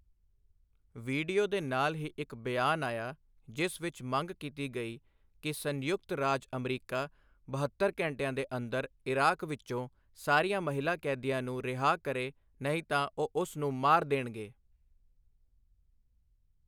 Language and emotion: Punjabi, neutral